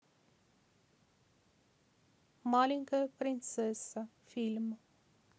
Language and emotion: Russian, neutral